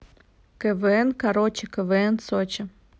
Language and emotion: Russian, neutral